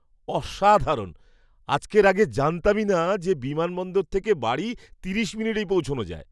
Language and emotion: Bengali, surprised